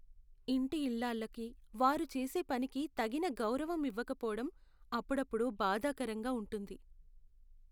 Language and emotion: Telugu, sad